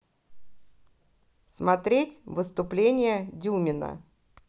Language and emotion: Russian, positive